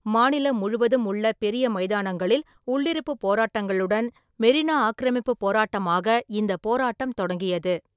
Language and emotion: Tamil, neutral